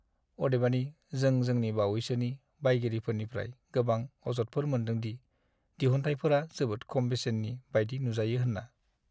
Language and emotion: Bodo, sad